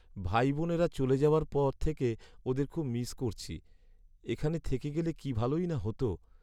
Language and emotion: Bengali, sad